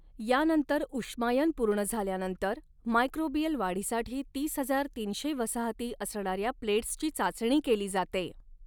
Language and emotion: Marathi, neutral